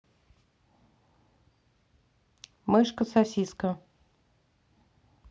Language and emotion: Russian, neutral